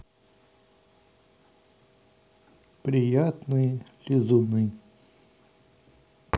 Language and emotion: Russian, neutral